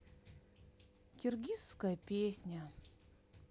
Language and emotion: Russian, sad